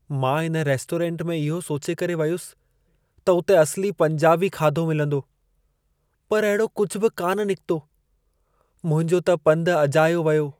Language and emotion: Sindhi, sad